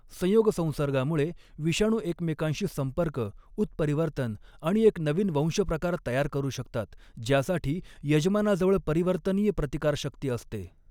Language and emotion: Marathi, neutral